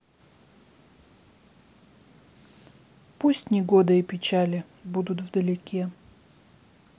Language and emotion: Russian, sad